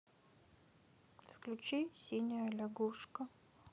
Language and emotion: Russian, sad